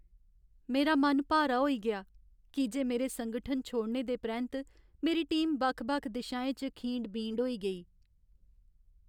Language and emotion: Dogri, sad